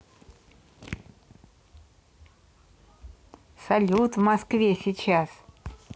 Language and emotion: Russian, positive